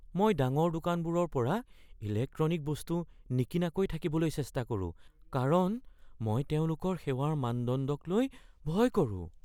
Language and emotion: Assamese, fearful